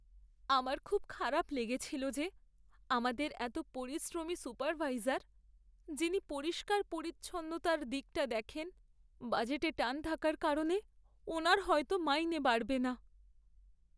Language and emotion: Bengali, sad